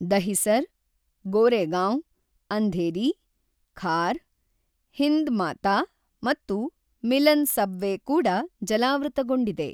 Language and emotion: Kannada, neutral